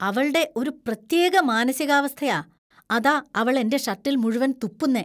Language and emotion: Malayalam, disgusted